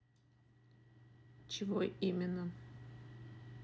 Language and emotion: Russian, neutral